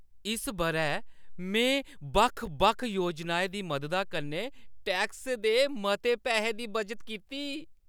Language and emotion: Dogri, happy